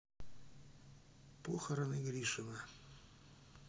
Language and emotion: Russian, neutral